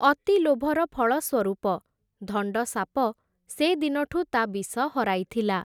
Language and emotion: Odia, neutral